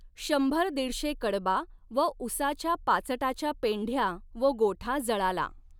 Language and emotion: Marathi, neutral